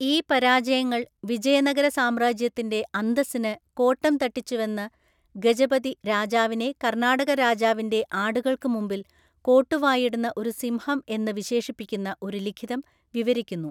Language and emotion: Malayalam, neutral